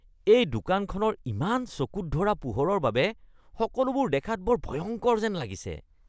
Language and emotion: Assamese, disgusted